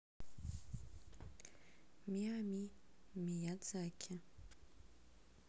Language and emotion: Russian, neutral